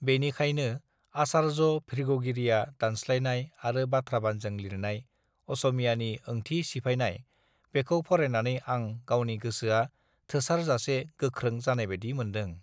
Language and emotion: Bodo, neutral